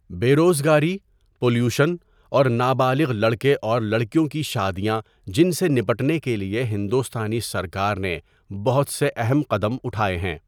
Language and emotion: Urdu, neutral